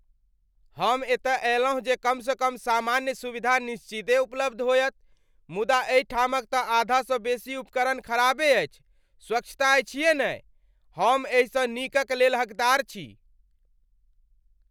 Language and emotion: Maithili, angry